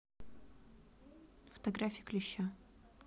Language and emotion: Russian, neutral